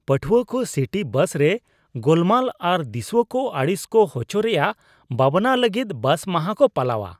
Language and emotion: Santali, disgusted